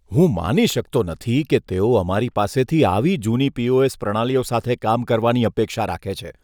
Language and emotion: Gujarati, disgusted